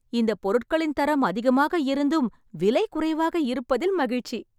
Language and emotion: Tamil, happy